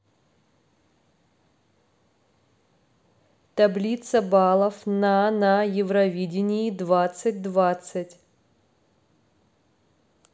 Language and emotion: Russian, neutral